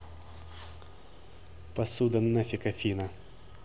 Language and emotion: Russian, angry